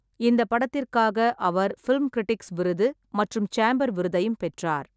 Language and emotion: Tamil, neutral